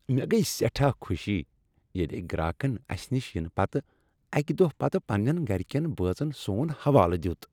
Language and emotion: Kashmiri, happy